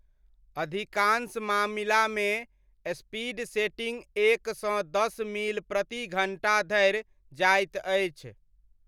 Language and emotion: Maithili, neutral